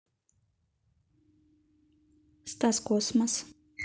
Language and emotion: Russian, neutral